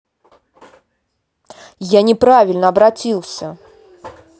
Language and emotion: Russian, angry